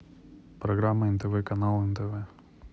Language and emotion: Russian, neutral